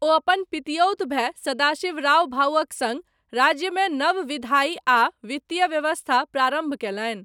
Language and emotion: Maithili, neutral